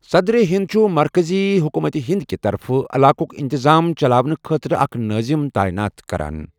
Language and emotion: Kashmiri, neutral